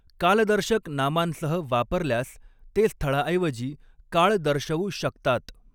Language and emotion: Marathi, neutral